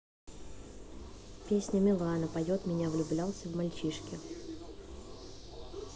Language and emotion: Russian, neutral